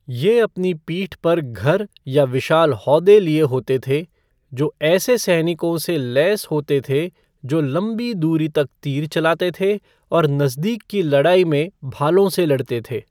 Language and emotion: Hindi, neutral